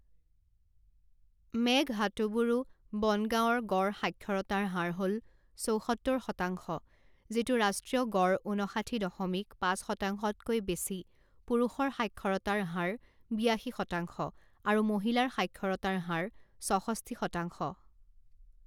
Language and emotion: Assamese, neutral